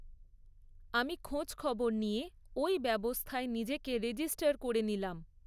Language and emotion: Bengali, neutral